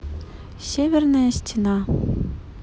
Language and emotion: Russian, neutral